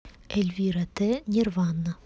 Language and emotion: Russian, neutral